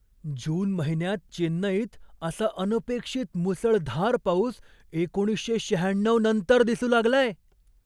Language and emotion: Marathi, surprised